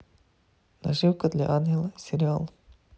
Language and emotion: Russian, neutral